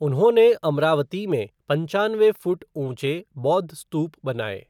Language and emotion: Hindi, neutral